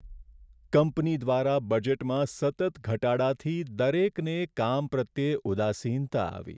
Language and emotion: Gujarati, sad